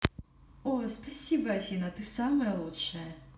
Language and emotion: Russian, positive